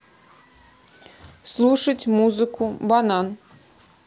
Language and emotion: Russian, neutral